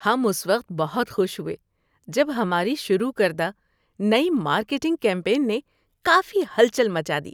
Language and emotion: Urdu, happy